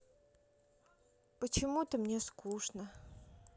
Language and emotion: Russian, sad